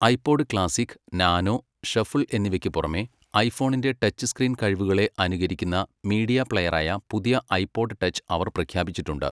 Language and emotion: Malayalam, neutral